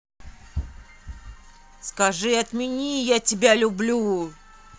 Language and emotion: Russian, angry